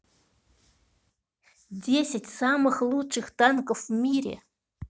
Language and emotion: Russian, neutral